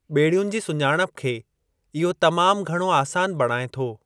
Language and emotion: Sindhi, neutral